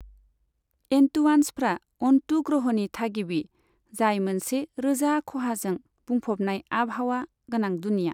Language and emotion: Bodo, neutral